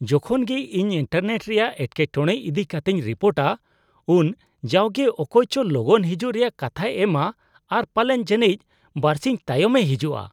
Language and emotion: Santali, disgusted